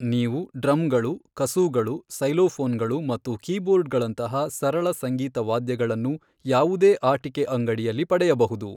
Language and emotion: Kannada, neutral